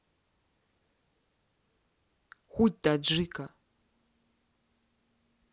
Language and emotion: Russian, neutral